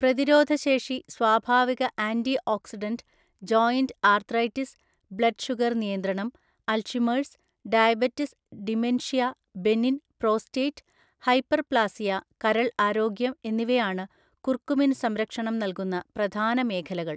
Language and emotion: Malayalam, neutral